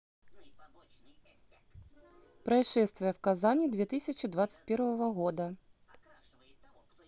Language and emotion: Russian, neutral